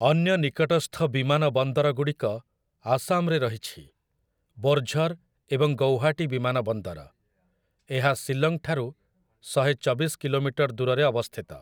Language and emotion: Odia, neutral